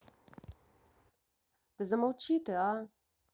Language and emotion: Russian, angry